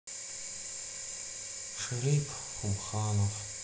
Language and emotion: Russian, sad